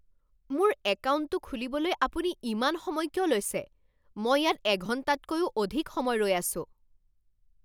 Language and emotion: Assamese, angry